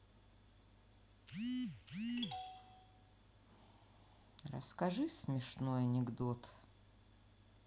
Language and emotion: Russian, sad